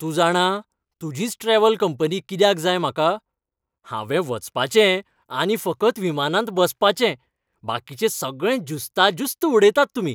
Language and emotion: Goan Konkani, happy